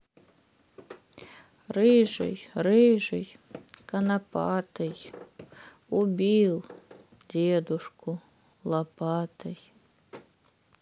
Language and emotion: Russian, sad